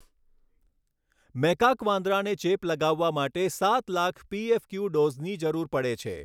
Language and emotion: Gujarati, neutral